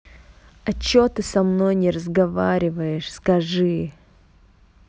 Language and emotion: Russian, angry